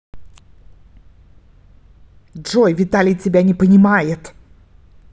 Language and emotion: Russian, angry